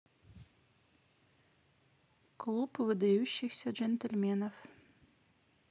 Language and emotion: Russian, neutral